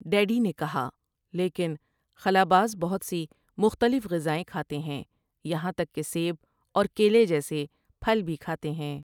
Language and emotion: Urdu, neutral